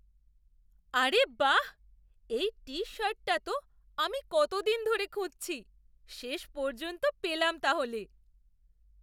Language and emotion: Bengali, surprised